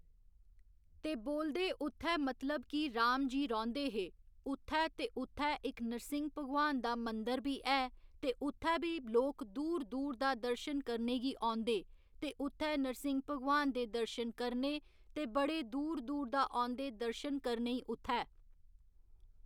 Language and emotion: Dogri, neutral